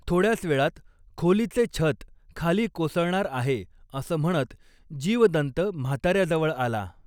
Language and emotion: Marathi, neutral